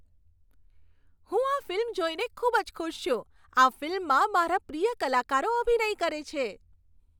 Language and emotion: Gujarati, happy